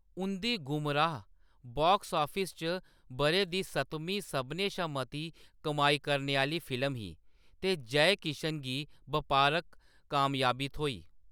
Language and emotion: Dogri, neutral